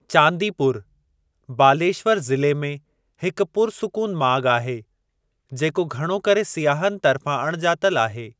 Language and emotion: Sindhi, neutral